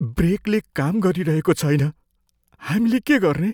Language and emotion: Nepali, fearful